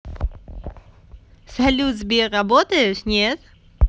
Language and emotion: Russian, positive